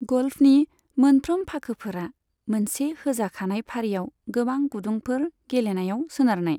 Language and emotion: Bodo, neutral